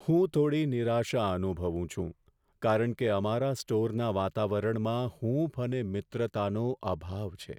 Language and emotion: Gujarati, sad